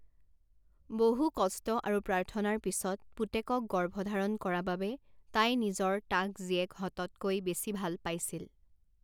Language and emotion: Assamese, neutral